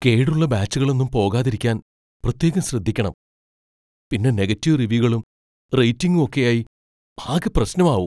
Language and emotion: Malayalam, fearful